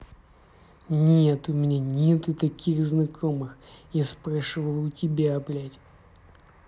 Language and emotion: Russian, angry